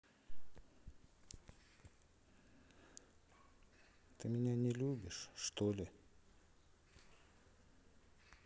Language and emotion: Russian, sad